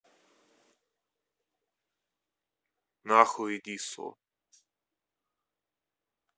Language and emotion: Russian, angry